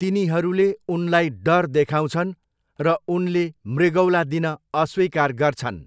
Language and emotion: Nepali, neutral